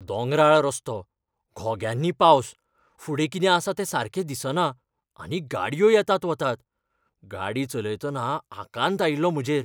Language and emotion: Goan Konkani, fearful